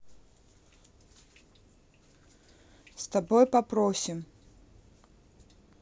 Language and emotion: Russian, neutral